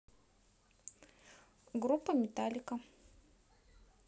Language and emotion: Russian, neutral